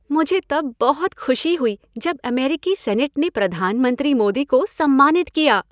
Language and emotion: Hindi, happy